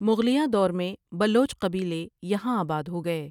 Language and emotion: Urdu, neutral